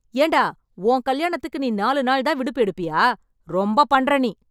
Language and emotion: Tamil, angry